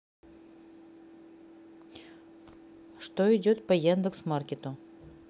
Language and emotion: Russian, neutral